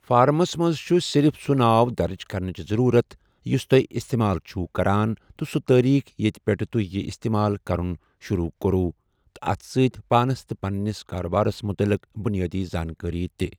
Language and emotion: Kashmiri, neutral